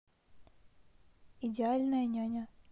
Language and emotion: Russian, neutral